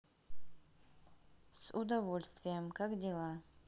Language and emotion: Russian, neutral